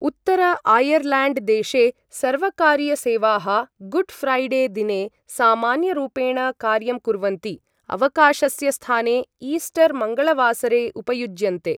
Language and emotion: Sanskrit, neutral